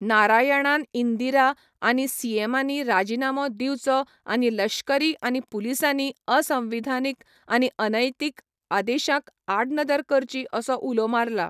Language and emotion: Goan Konkani, neutral